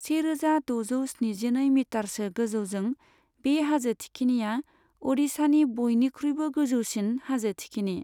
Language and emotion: Bodo, neutral